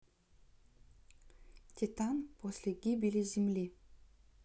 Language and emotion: Russian, neutral